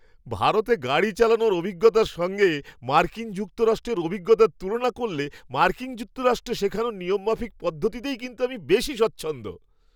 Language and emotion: Bengali, happy